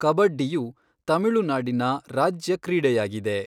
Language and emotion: Kannada, neutral